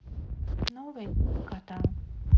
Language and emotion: Russian, neutral